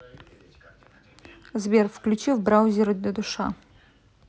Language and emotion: Russian, neutral